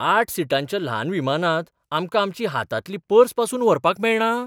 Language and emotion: Goan Konkani, surprised